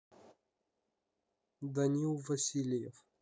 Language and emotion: Russian, neutral